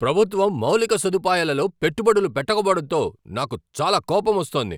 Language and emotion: Telugu, angry